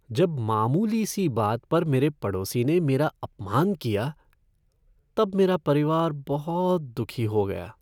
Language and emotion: Hindi, sad